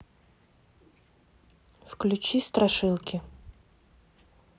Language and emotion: Russian, neutral